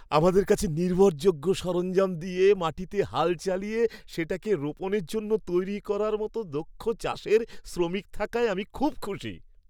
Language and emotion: Bengali, happy